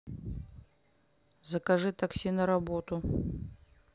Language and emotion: Russian, neutral